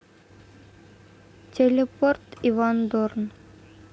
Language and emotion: Russian, neutral